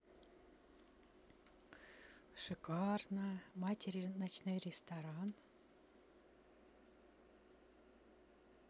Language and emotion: Russian, neutral